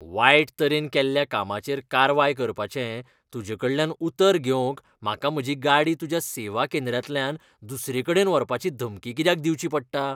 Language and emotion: Goan Konkani, disgusted